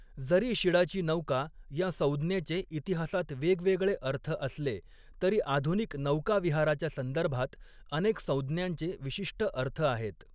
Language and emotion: Marathi, neutral